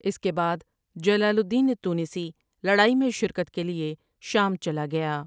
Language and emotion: Urdu, neutral